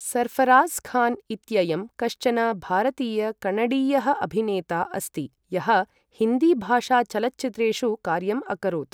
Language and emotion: Sanskrit, neutral